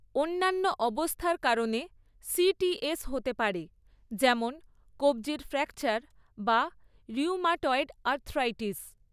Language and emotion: Bengali, neutral